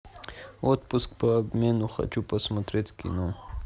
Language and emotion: Russian, neutral